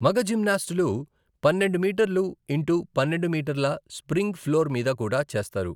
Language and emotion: Telugu, neutral